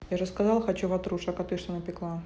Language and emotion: Russian, neutral